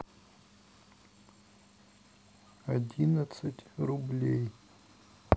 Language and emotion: Russian, neutral